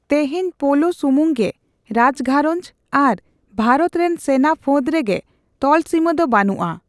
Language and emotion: Santali, neutral